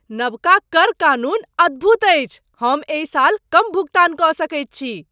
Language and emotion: Maithili, surprised